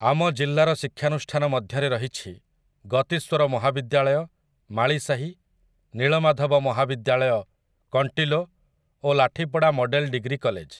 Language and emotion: Odia, neutral